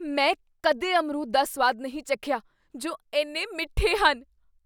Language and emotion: Punjabi, surprised